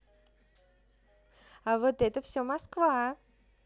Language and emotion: Russian, positive